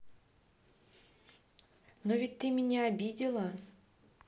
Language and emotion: Russian, neutral